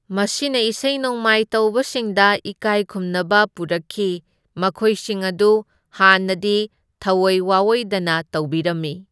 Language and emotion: Manipuri, neutral